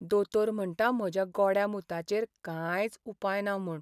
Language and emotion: Goan Konkani, sad